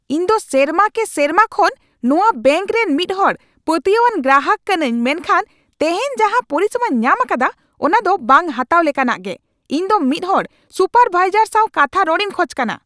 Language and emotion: Santali, angry